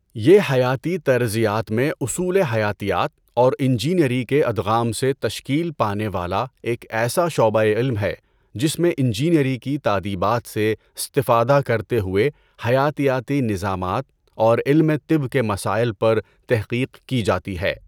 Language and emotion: Urdu, neutral